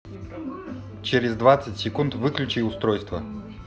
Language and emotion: Russian, neutral